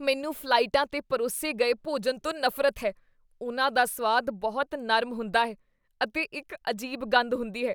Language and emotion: Punjabi, disgusted